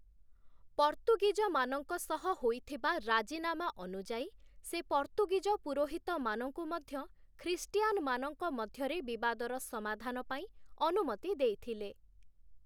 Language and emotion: Odia, neutral